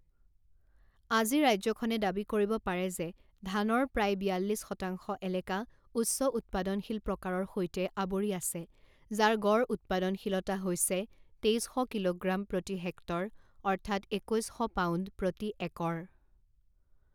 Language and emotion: Assamese, neutral